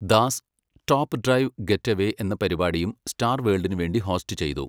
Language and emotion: Malayalam, neutral